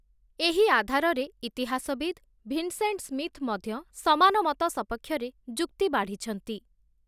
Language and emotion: Odia, neutral